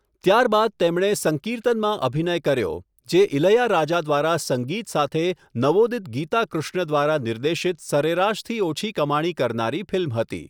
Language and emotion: Gujarati, neutral